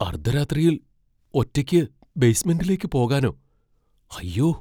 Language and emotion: Malayalam, fearful